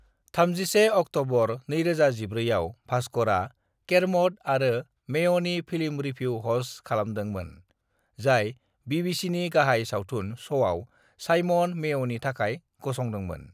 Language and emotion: Bodo, neutral